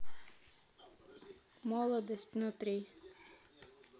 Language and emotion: Russian, neutral